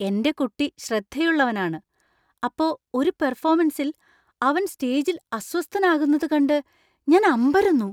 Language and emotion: Malayalam, surprised